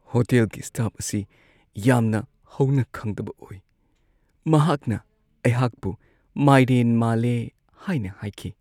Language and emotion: Manipuri, sad